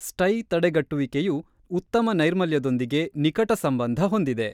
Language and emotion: Kannada, neutral